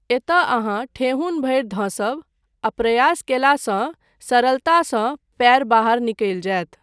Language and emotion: Maithili, neutral